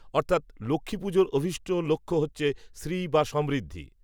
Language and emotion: Bengali, neutral